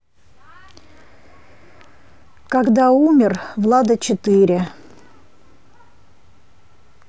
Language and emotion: Russian, neutral